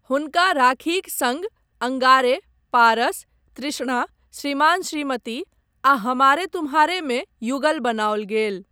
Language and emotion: Maithili, neutral